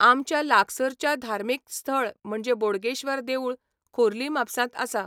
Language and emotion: Goan Konkani, neutral